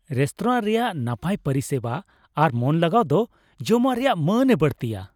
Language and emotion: Santali, happy